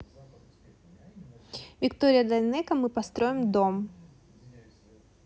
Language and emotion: Russian, neutral